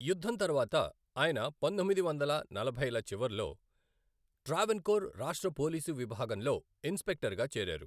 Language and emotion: Telugu, neutral